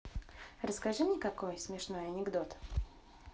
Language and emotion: Russian, positive